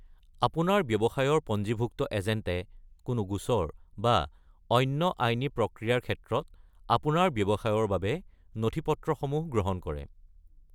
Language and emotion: Assamese, neutral